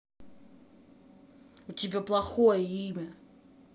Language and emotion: Russian, angry